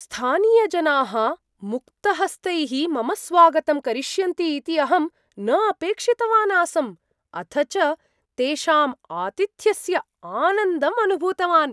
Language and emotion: Sanskrit, surprised